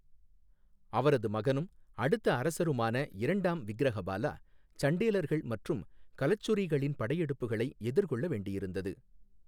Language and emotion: Tamil, neutral